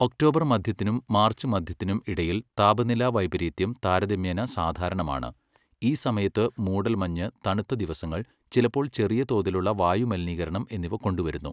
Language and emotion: Malayalam, neutral